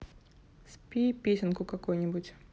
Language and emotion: Russian, neutral